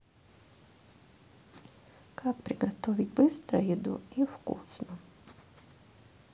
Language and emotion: Russian, sad